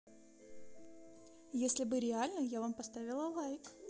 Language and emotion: Russian, neutral